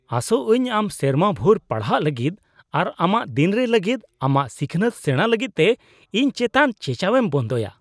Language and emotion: Santali, disgusted